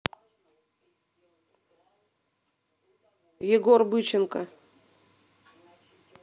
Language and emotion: Russian, neutral